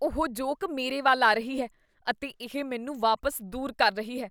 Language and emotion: Punjabi, disgusted